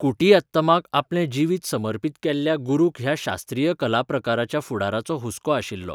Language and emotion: Goan Konkani, neutral